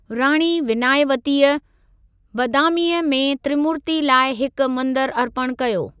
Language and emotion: Sindhi, neutral